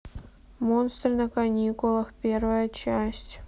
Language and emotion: Russian, neutral